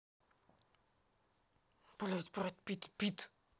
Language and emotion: Russian, angry